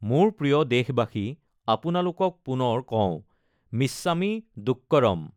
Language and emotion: Assamese, neutral